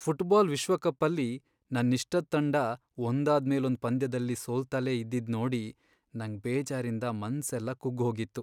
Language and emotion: Kannada, sad